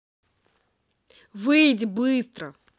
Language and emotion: Russian, angry